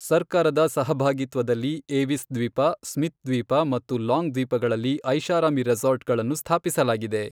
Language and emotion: Kannada, neutral